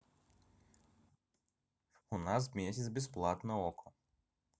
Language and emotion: Russian, neutral